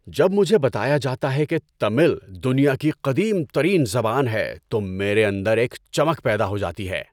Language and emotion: Urdu, happy